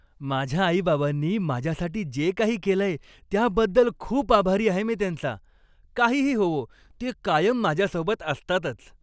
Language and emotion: Marathi, happy